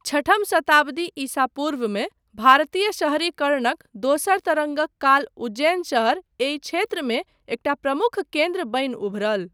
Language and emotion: Maithili, neutral